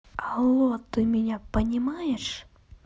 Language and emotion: Russian, neutral